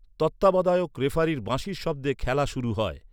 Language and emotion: Bengali, neutral